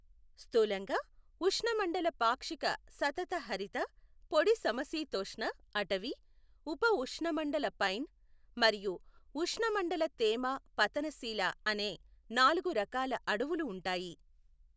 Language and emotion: Telugu, neutral